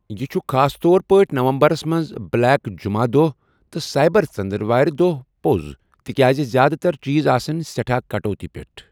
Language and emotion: Kashmiri, neutral